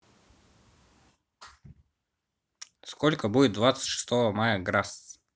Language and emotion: Russian, neutral